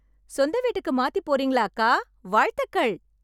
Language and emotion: Tamil, happy